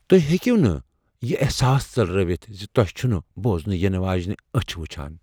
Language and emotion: Kashmiri, fearful